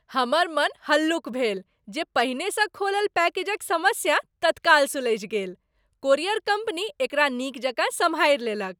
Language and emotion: Maithili, happy